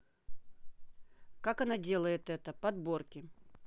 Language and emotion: Russian, neutral